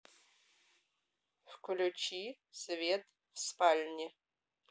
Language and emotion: Russian, neutral